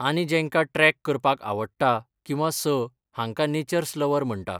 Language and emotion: Goan Konkani, neutral